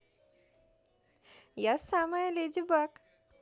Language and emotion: Russian, positive